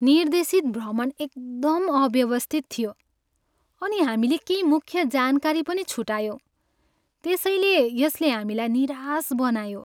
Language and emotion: Nepali, sad